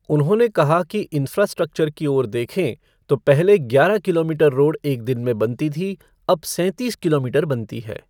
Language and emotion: Hindi, neutral